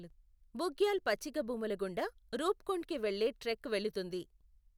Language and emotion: Telugu, neutral